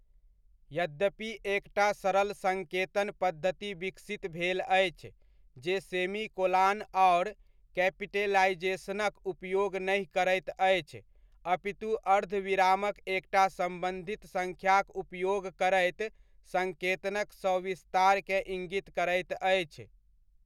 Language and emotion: Maithili, neutral